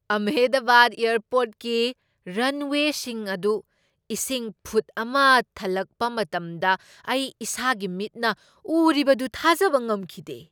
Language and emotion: Manipuri, surprised